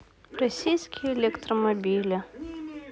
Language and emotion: Russian, sad